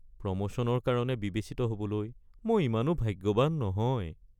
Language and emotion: Assamese, sad